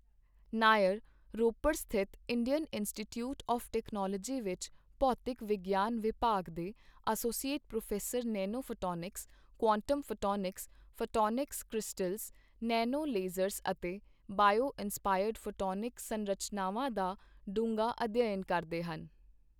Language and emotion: Punjabi, neutral